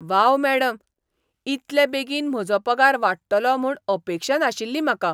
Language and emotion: Goan Konkani, surprised